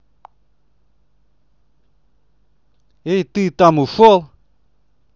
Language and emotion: Russian, angry